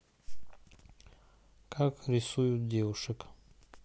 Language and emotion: Russian, neutral